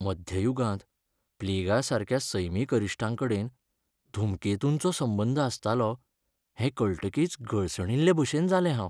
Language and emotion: Goan Konkani, sad